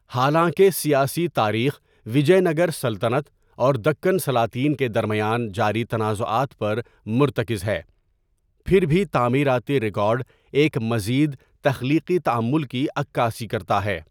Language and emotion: Urdu, neutral